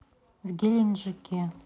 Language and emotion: Russian, neutral